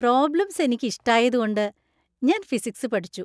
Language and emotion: Malayalam, happy